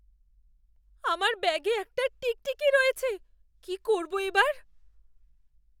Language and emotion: Bengali, fearful